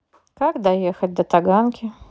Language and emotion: Russian, neutral